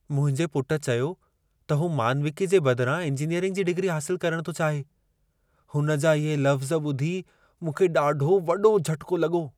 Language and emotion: Sindhi, surprised